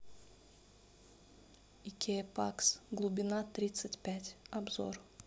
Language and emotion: Russian, neutral